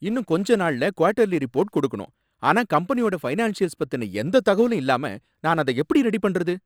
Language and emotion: Tamil, angry